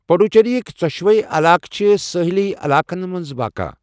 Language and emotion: Kashmiri, neutral